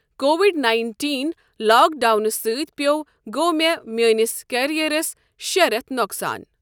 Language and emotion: Kashmiri, neutral